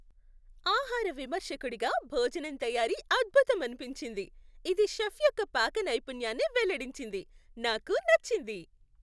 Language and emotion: Telugu, happy